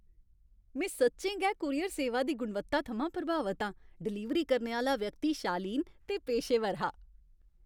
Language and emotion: Dogri, happy